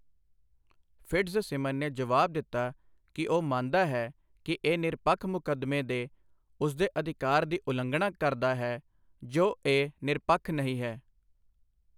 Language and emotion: Punjabi, neutral